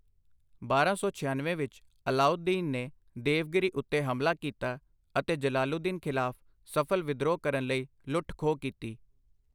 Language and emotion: Punjabi, neutral